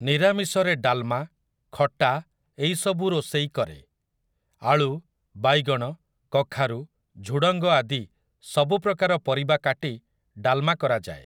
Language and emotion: Odia, neutral